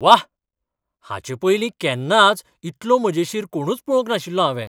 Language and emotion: Goan Konkani, surprised